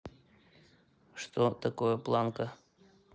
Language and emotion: Russian, neutral